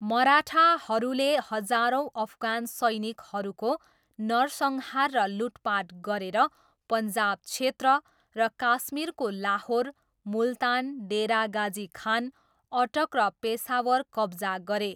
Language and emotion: Nepali, neutral